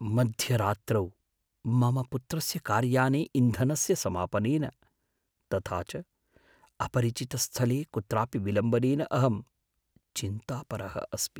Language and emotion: Sanskrit, fearful